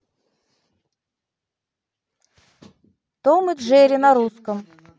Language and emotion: Russian, neutral